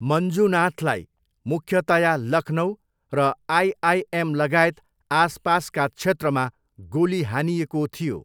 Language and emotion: Nepali, neutral